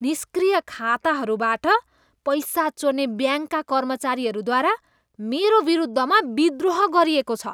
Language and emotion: Nepali, disgusted